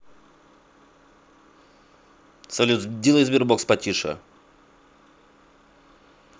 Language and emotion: Russian, angry